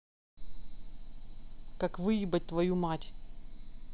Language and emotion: Russian, angry